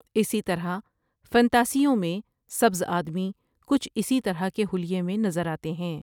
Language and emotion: Urdu, neutral